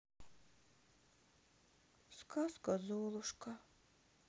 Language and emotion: Russian, sad